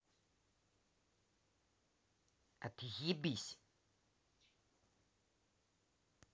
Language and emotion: Russian, angry